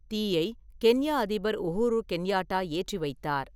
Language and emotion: Tamil, neutral